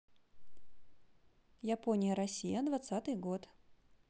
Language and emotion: Russian, neutral